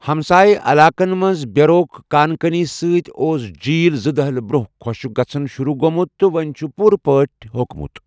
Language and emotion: Kashmiri, neutral